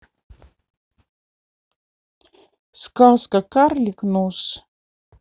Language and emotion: Russian, neutral